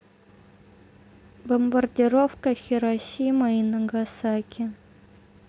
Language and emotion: Russian, neutral